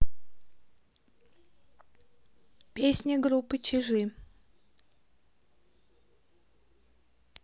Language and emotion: Russian, neutral